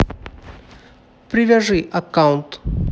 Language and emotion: Russian, neutral